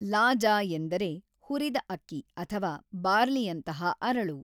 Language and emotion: Kannada, neutral